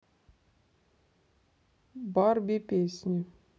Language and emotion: Russian, neutral